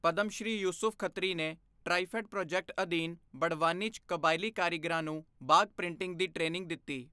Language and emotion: Punjabi, neutral